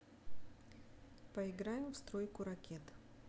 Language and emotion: Russian, neutral